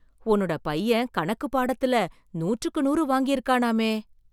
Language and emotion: Tamil, surprised